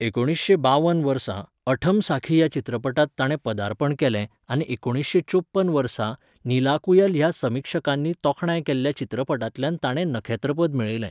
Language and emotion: Goan Konkani, neutral